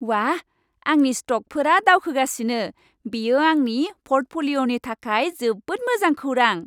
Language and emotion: Bodo, happy